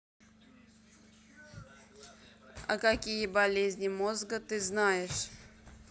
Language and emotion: Russian, neutral